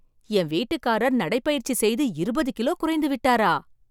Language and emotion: Tamil, surprised